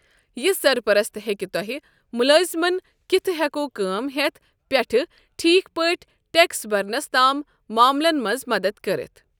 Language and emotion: Kashmiri, neutral